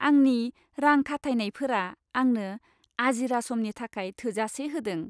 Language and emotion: Bodo, happy